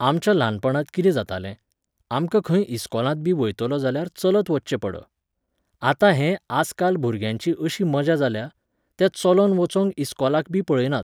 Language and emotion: Goan Konkani, neutral